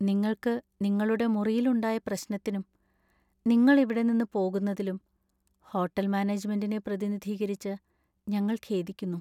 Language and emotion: Malayalam, sad